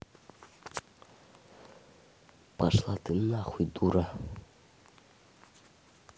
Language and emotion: Russian, angry